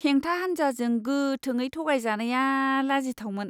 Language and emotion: Bodo, disgusted